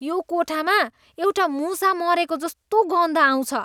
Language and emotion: Nepali, disgusted